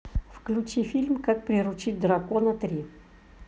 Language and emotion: Russian, neutral